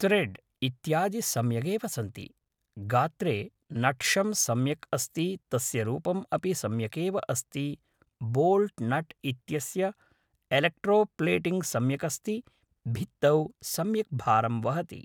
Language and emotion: Sanskrit, neutral